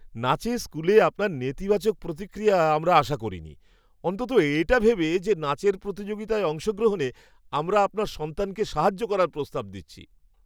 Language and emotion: Bengali, surprised